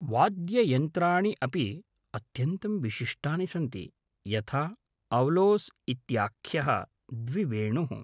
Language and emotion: Sanskrit, neutral